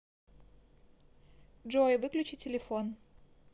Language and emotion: Russian, neutral